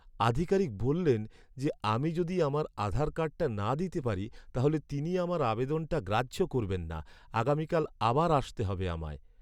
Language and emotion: Bengali, sad